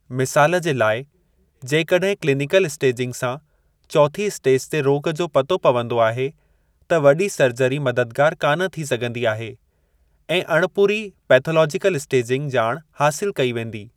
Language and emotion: Sindhi, neutral